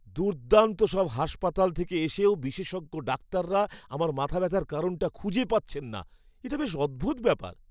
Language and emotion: Bengali, surprised